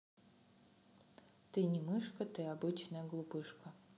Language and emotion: Russian, neutral